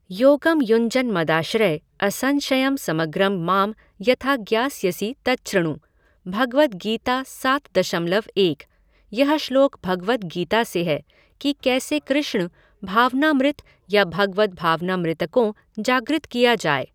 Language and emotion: Hindi, neutral